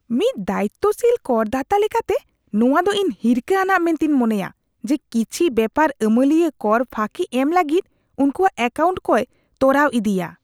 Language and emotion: Santali, disgusted